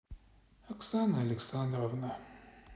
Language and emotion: Russian, sad